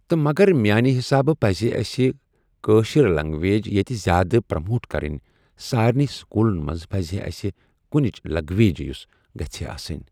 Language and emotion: Kashmiri, neutral